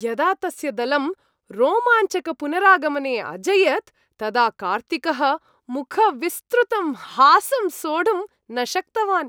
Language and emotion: Sanskrit, happy